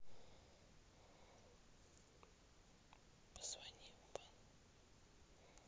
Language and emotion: Russian, neutral